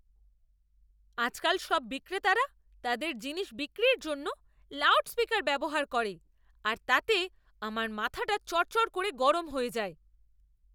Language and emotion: Bengali, angry